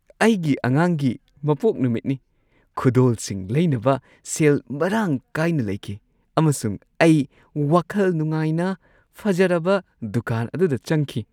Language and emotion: Manipuri, happy